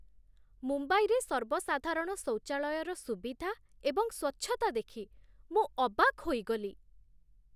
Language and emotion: Odia, surprised